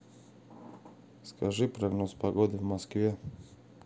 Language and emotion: Russian, neutral